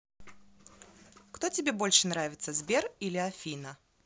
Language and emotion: Russian, positive